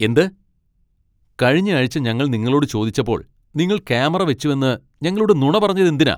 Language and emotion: Malayalam, angry